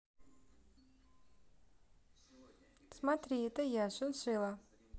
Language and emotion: Russian, neutral